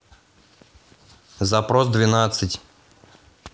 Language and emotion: Russian, neutral